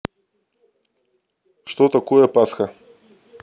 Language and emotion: Russian, neutral